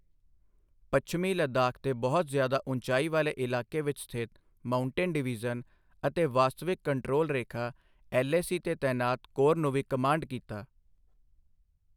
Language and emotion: Punjabi, neutral